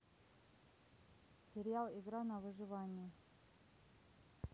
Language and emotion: Russian, neutral